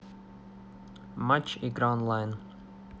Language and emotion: Russian, neutral